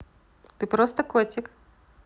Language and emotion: Russian, positive